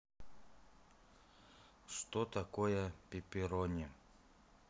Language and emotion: Russian, neutral